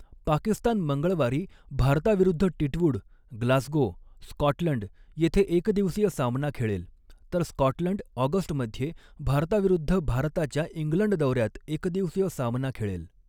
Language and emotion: Marathi, neutral